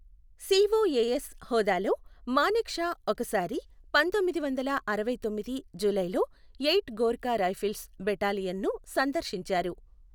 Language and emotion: Telugu, neutral